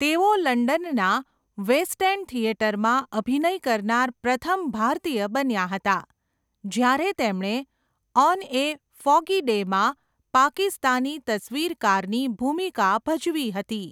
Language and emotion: Gujarati, neutral